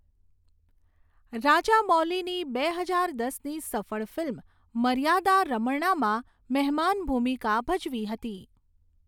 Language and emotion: Gujarati, neutral